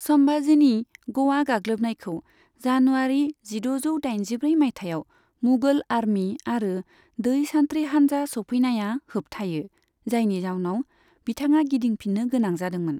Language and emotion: Bodo, neutral